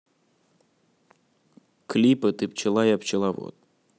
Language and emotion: Russian, neutral